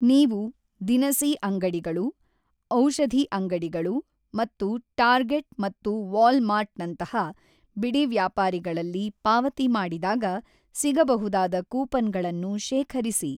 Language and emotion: Kannada, neutral